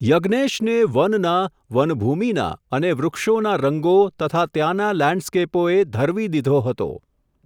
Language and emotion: Gujarati, neutral